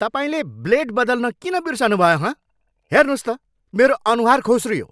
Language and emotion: Nepali, angry